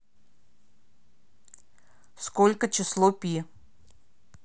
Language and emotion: Russian, neutral